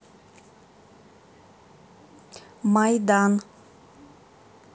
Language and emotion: Russian, neutral